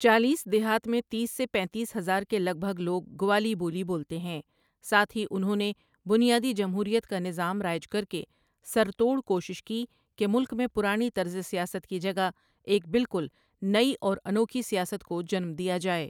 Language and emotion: Urdu, neutral